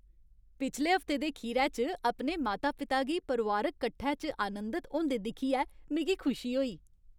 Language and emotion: Dogri, happy